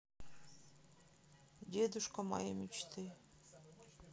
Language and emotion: Russian, neutral